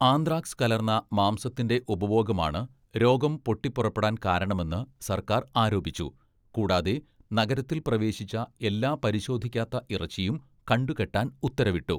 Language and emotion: Malayalam, neutral